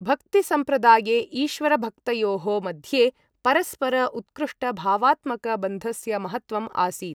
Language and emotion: Sanskrit, neutral